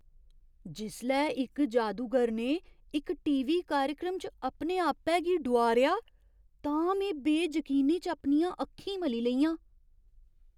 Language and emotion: Dogri, surprised